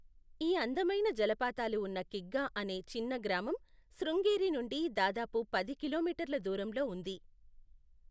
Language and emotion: Telugu, neutral